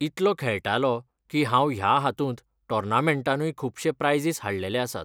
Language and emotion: Goan Konkani, neutral